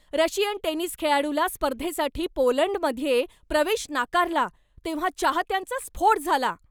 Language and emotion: Marathi, angry